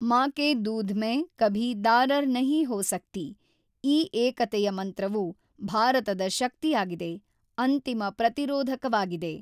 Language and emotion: Kannada, neutral